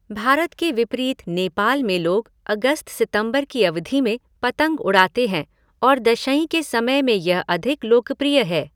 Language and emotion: Hindi, neutral